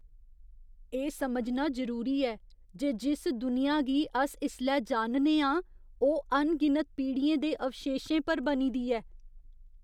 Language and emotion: Dogri, fearful